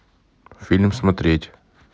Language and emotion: Russian, neutral